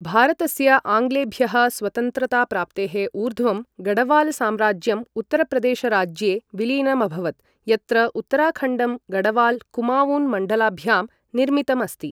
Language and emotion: Sanskrit, neutral